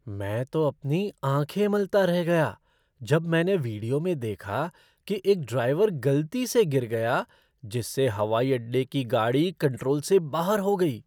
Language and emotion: Hindi, surprised